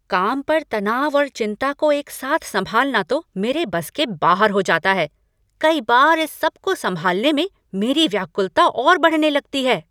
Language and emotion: Hindi, angry